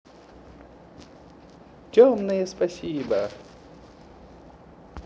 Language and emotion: Russian, positive